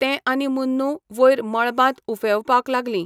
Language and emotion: Goan Konkani, neutral